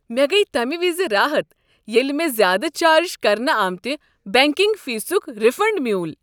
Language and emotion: Kashmiri, happy